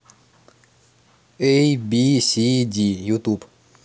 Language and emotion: Russian, neutral